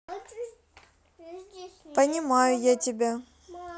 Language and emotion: Russian, neutral